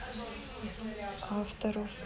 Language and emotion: Russian, neutral